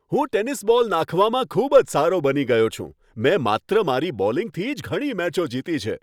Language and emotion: Gujarati, happy